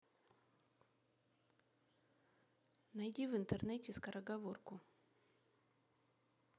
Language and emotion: Russian, neutral